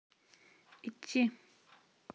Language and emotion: Russian, neutral